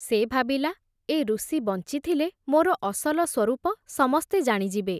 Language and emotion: Odia, neutral